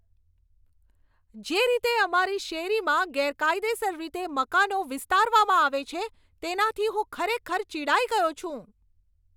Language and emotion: Gujarati, angry